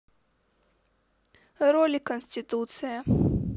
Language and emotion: Russian, neutral